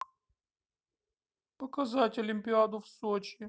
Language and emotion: Russian, sad